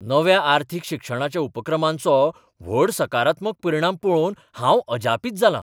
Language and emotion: Goan Konkani, surprised